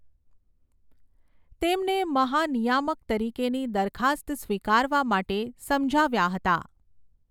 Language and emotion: Gujarati, neutral